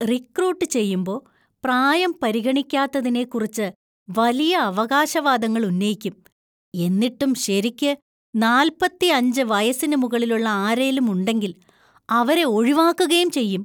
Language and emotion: Malayalam, disgusted